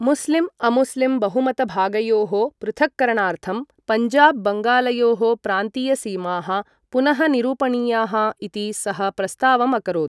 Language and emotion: Sanskrit, neutral